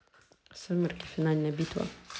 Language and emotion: Russian, neutral